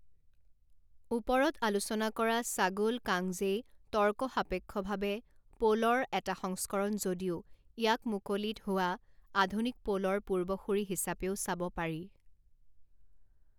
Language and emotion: Assamese, neutral